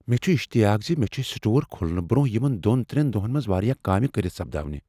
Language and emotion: Kashmiri, fearful